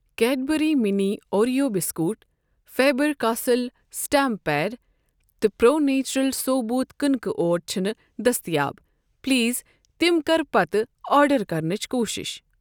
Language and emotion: Kashmiri, neutral